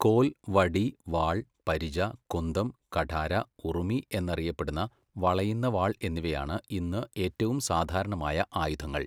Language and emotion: Malayalam, neutral